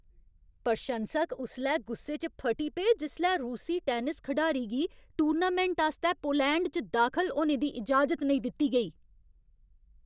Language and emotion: Dogri, angry